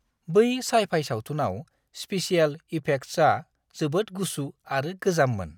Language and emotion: Bodo, disgusted